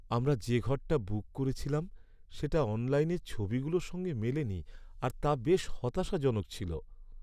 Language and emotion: Bengali, sad